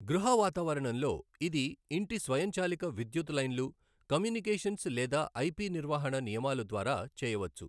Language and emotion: Telugu, neutral